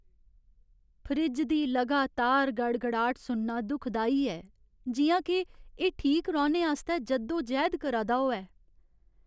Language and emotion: Dogri, sad